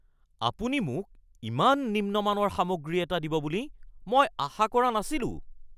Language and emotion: Assamese, angry